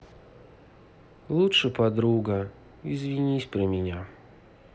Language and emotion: Russian, sad